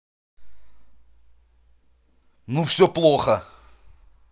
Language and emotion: Russian, angry